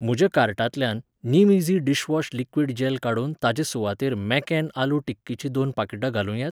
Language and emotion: Goan Konkani, neutral